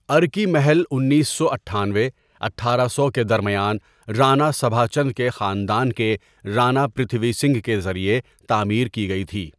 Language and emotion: Urdu, neutral